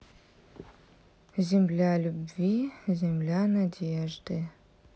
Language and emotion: Russian, neutral